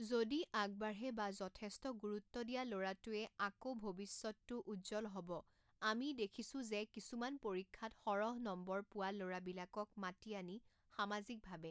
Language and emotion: Assamese, neutral